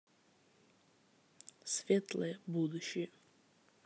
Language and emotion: Russian, neutral